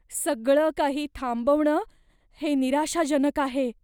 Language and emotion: Marathi, fearful